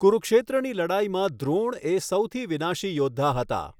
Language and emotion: Gujarati, neutral